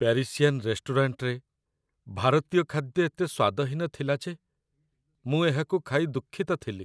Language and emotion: Odia, sad